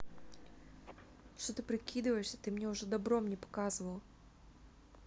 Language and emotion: Russian, angry